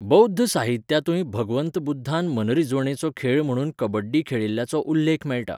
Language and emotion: Goan Konkani, neutral